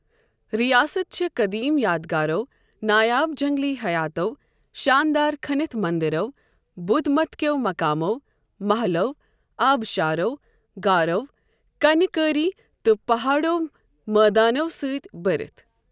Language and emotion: Kashmiri, neutral